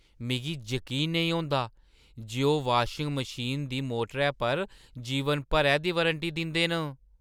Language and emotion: Dogri, surprised